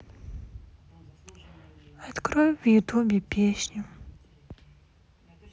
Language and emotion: Russian, sad